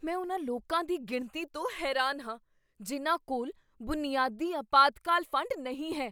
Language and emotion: Punjabi, surprised